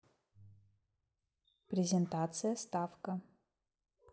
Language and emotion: Russian, neutral